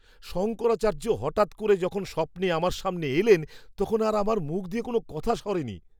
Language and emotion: Bengali, surprised